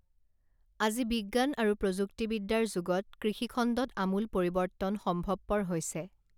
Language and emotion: Assamese, neutral